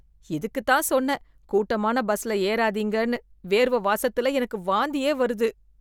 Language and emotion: Tamil, disgusted